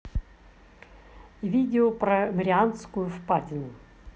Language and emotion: Russian, neutral